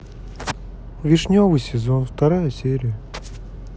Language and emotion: Russian, sad